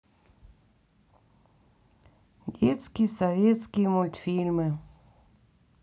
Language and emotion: Russian, sad